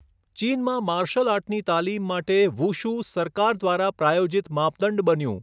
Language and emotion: Gujarati, neutral